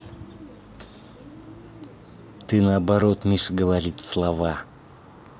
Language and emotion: Russian, angry